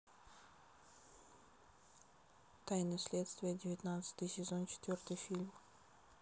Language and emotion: Russian, neutral